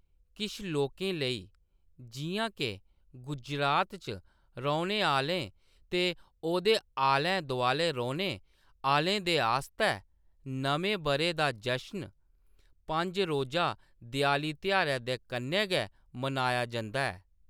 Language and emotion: Dogri, neutral